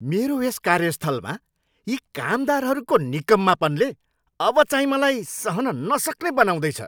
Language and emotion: Nepali, angry